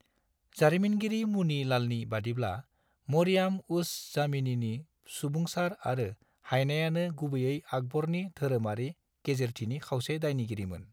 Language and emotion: Bodo, neutral